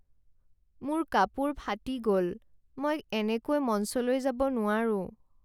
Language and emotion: Assamese, sad